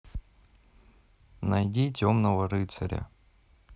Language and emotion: Russian, neutral